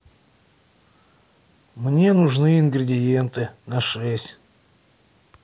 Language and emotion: Russian, neutral